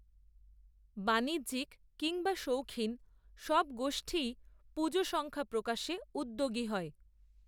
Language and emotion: Bengali, neutral